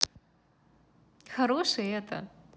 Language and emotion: Russian, positive